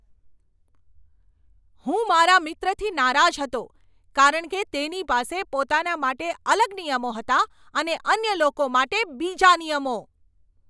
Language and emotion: Gujarati, angry